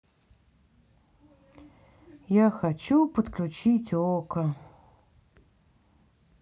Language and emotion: Russian, sad